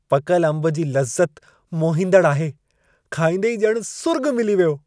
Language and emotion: Sindhi, happy